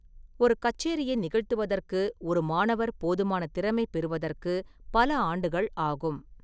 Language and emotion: Tamil, neutral